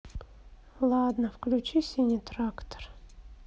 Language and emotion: Russian, sad